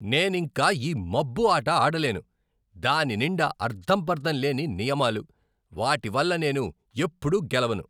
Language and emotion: Telugu, angry